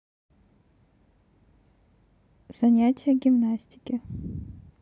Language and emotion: Russian, neutral